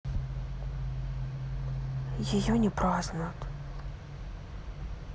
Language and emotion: Russian, sad